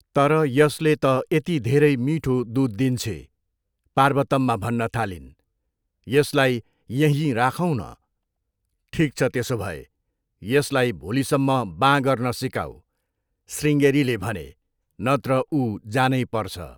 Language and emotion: Nepali, neutral